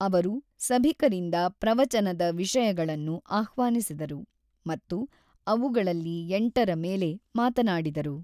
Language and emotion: Kannada, neutral